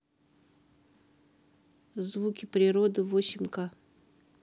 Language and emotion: Russian, neutral